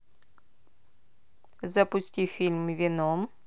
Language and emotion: Russian, neutral